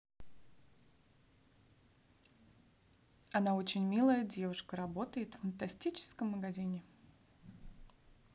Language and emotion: Russian, neutral